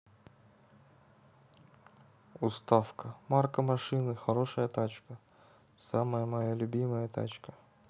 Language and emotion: Russian, neutral